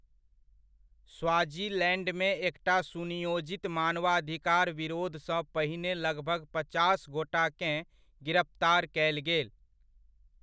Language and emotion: Maithili, neutral